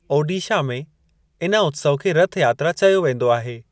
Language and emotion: Sindhi, neutral